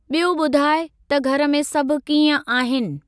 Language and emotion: Sindhi, neutral